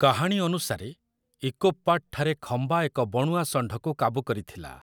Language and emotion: Odia, neutral